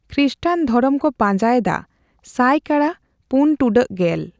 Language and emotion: Santali, neutral